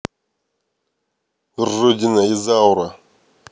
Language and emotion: Russian, angry